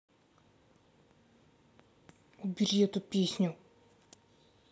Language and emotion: Russian, angry